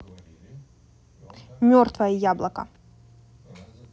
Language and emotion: Russian, neutral